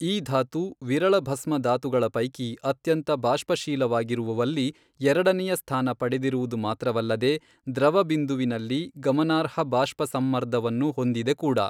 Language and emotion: Kannada, neutral